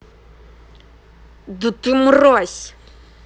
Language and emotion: Russian, angry